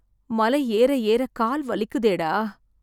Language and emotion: Tamil, sad